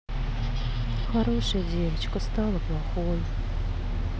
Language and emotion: Russian, sad